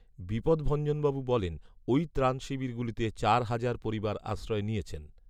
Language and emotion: Bengali, neutral